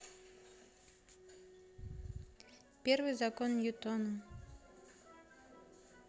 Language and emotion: Russian, neutral